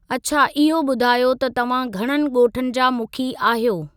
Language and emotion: Sindhi, neutral